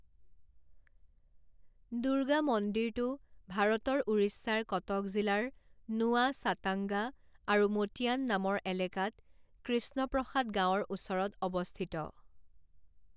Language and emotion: Assamese, neutral